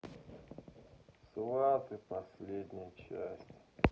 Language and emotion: Russian, sad